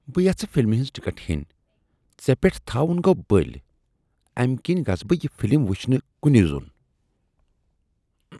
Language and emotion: Kashmiri, disgusted